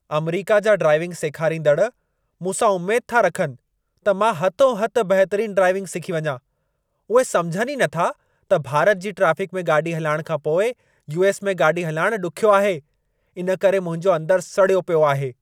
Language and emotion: Sindhi, angry